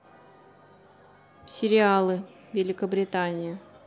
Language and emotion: Russian, neutral